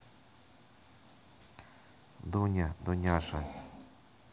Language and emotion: Russian, neutral